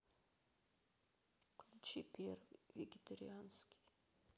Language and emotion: Russian, neutral